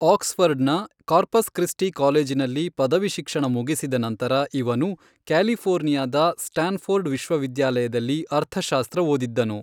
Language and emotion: Kannada, neutral